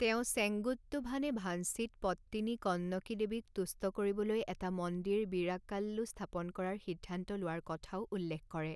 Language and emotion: Assamese, neutral